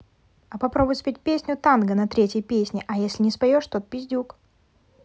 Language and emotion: Russian, neutral